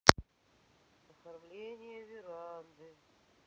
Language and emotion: Russian, sad